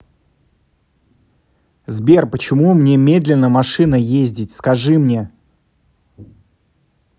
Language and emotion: Russian, angry